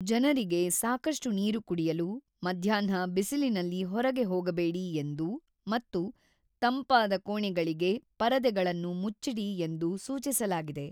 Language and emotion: Kannada, neutral